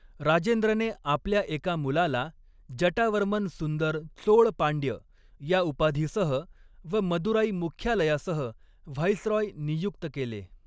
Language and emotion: Marathi, neutral